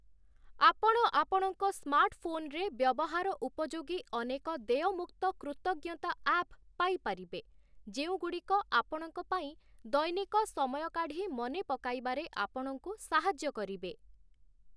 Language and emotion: Odia, neutral